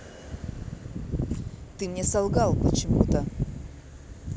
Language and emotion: Russian, neutral